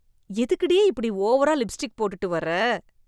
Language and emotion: Tamil, disgusted